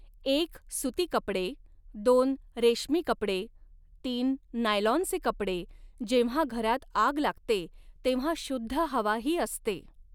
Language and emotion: Marathi, neutral